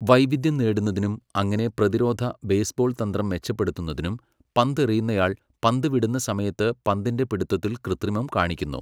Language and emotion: Malayalam, neutral